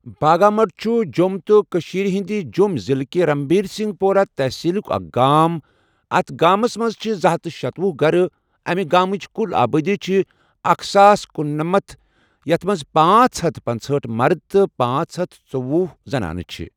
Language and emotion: Kashmiri, neutral